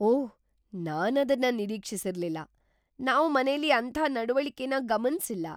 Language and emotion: Kannada, surprised